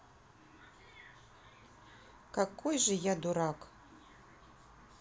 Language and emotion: Russian, neutral